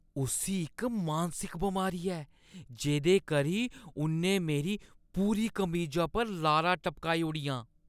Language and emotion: Dogri, disgusted